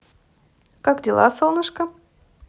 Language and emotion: Russian, positive